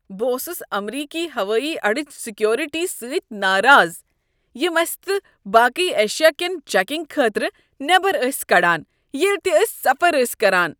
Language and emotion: Kashmiri, disgusted